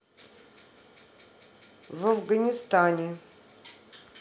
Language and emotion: Russian, neutral